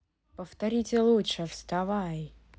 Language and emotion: Russian, neutral